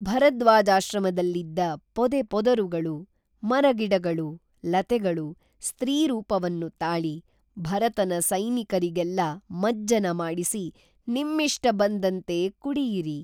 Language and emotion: Kannada, neutral